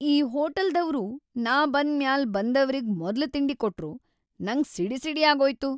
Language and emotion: Kannada, angry